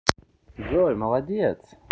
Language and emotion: Russian, positive